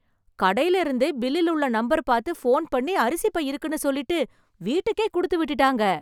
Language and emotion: Tamil, surprised